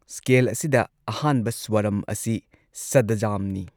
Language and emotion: Manipuri, neutral